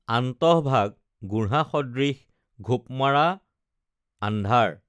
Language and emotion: Assamese, neutral